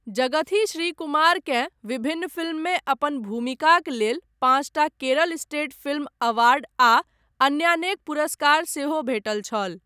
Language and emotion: Maithili, neutral